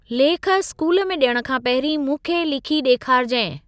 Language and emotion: Sindhi, neutral